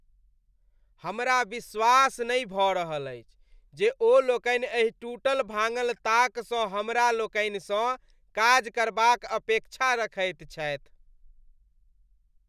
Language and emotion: Maithili, disgusted